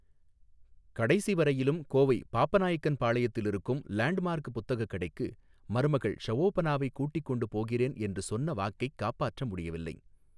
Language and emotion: Tamil, neutral